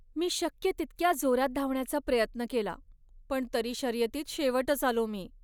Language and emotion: Marathi, sad